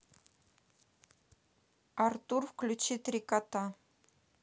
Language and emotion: Russian, neutral